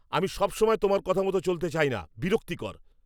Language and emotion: Bengali, angry